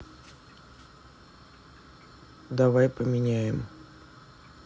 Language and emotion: Russian, neutral